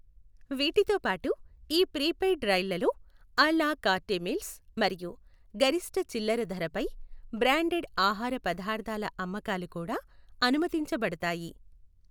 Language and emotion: Telugu, neutral